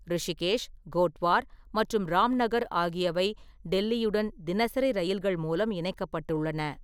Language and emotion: Tamil, neutral